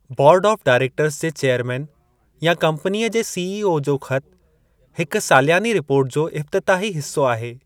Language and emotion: Sindhi, neutral